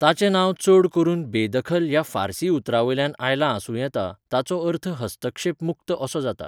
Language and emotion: Goan Konkani, neutral